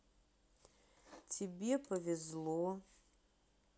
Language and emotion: Russian, neutral